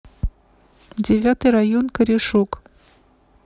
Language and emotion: Russian, neutral